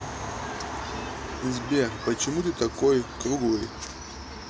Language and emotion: Russian, neutral